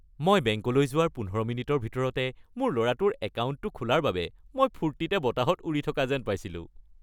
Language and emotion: Assamese, happy